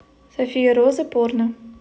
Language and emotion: Russian, neutral